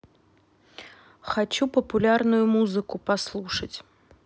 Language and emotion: Russian, neutral